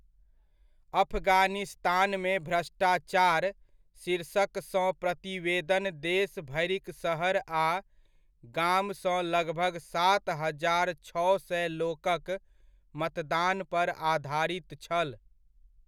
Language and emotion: Maithili, neutral